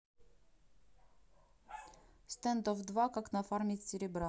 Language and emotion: Russian, neutral